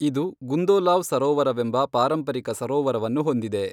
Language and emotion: Kannada, neutral